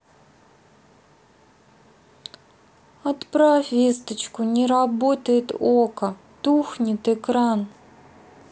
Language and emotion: Russian, sad